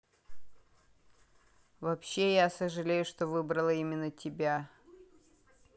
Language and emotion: Russian, neutral